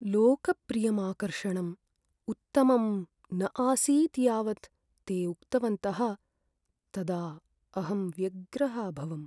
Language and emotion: Sanskrit, sad